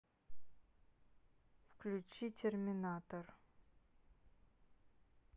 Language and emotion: Russian, neutral